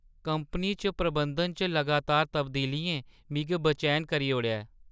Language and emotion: Dogri, sad